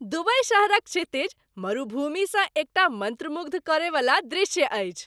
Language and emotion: Maithili, happy